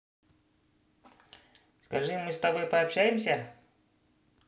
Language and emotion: Russian, positive